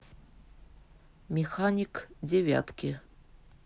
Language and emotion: Russian, neutral